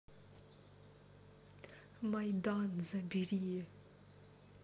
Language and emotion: Russian, neutral